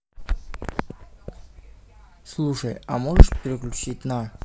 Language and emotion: Russian, neutral